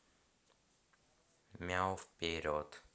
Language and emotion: Russian, neutral